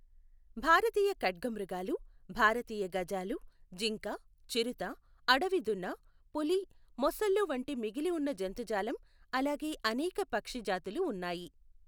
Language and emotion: Telugu, neutral